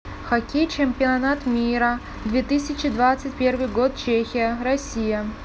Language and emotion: Russian, neutral